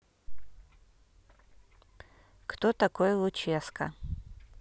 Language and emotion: Russian, neutral